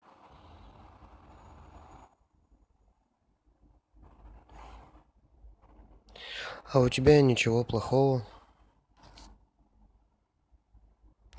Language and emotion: Russian, neutral